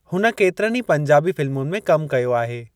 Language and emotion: Sindhi, neutral